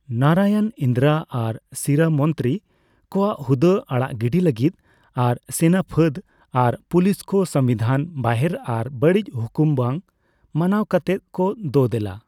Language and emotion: Santali, neutral